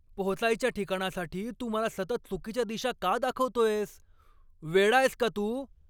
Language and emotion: Marathi, angry